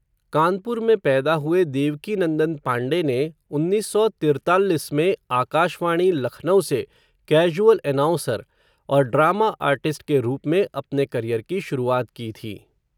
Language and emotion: Hindi, neutral